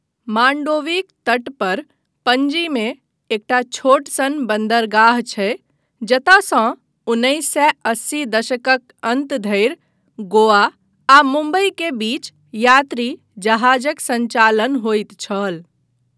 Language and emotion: Maithili, neutral